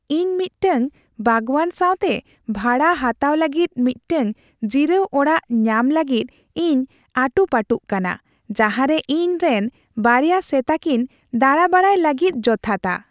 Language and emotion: Santali, happy